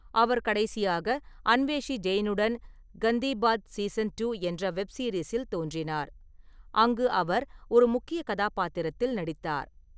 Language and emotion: Tamil, neutral